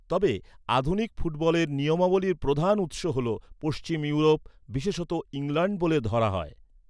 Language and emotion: Bengali, neutral